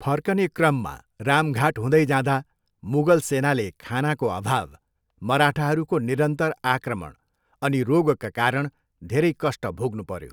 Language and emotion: Nepali, neutral